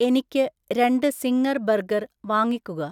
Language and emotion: Malayalam, neutral